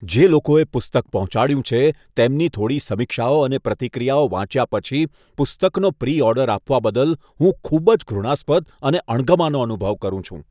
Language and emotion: Gujarati, disgusted